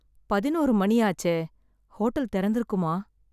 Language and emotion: Tamil, sad